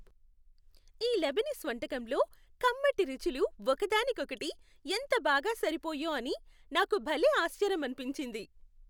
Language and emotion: Telugu, happy